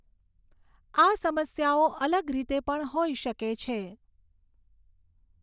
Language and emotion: Gujarati, neutral